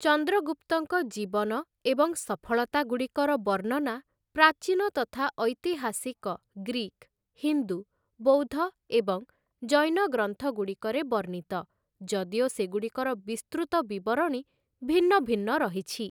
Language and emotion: Odia, neutral